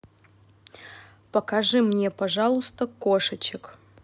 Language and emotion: Russian, neutral